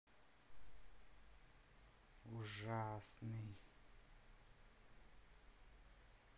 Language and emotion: Russian, neutral